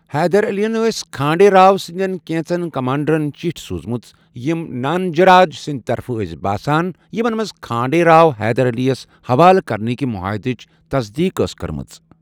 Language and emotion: Kashmiri, neutral